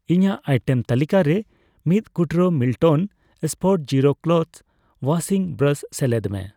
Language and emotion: Santali, neutral